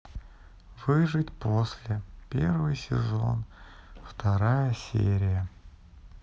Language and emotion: Russian, sad